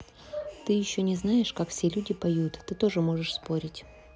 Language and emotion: Russian, neutral